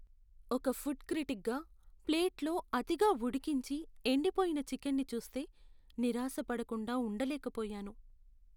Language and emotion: Telugu, sad